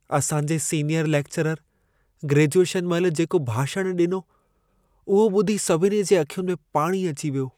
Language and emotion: Sindhi, sad